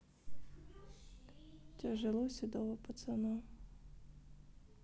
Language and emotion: Russian, sad